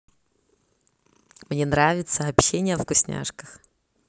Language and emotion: Russian, positive